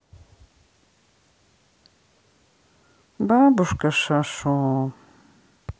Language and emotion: Russian, sad